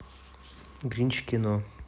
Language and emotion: Russian, neutral